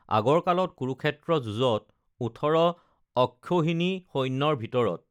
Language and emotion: Assamese, neutral